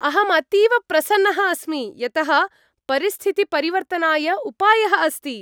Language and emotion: Sanskrit, happy